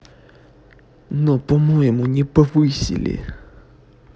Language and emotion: Russian, neutral